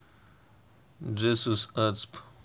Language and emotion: Russian, neutral